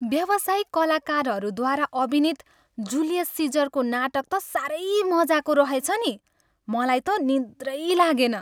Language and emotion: Nepali, happy